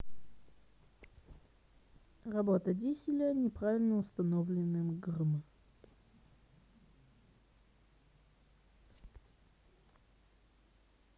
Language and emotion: Russian, neutral